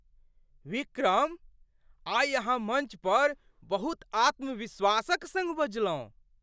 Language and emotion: Maithili, surprised